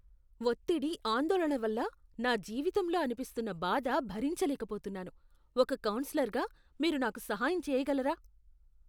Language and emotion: Telugu, disgusted